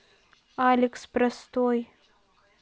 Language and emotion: Russian, neutral